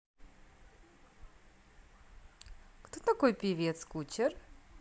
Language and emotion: Russian, positive